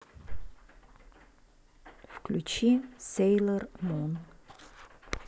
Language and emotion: Russian, neutral